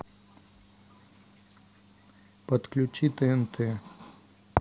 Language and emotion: Russian, neutral